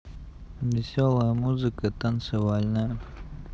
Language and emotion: Russian, neutral